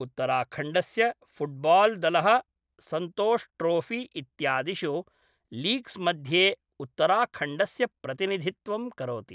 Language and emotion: Sanskrit, neutral